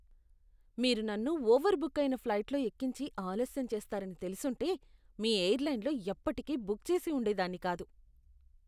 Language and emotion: Telugu, disgusted